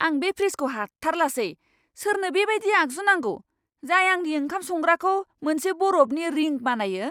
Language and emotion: Bodo, angry